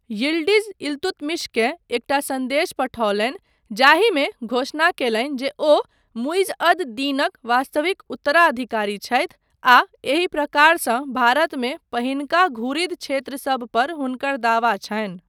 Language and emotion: Maithili, neutral